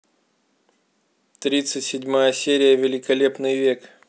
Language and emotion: Russian, neutral